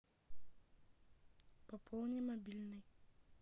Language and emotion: Russian, neutral